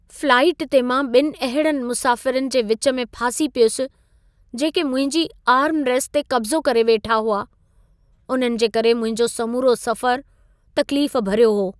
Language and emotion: Sindhi, sad